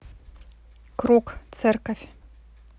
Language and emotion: Russian, neutral